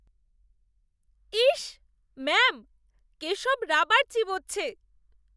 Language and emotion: Bengali, disgusted